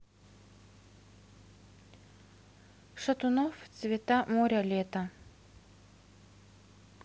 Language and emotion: Russian, neutral